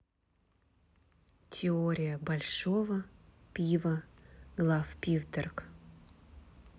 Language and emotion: Russian, neutral